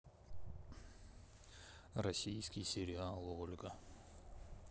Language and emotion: Russian, neutral